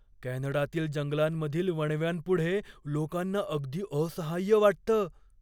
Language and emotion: Marathi, fearful